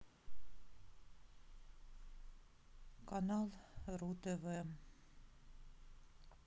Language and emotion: Russian, neutral